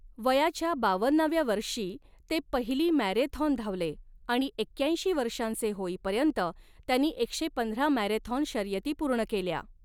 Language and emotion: Marathi, neutral